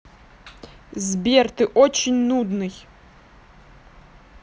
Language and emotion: Russian, angry